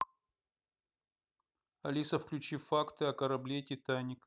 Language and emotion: Russian, neutral